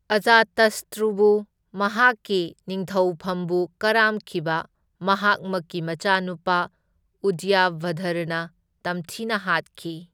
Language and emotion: Manipuri, neutral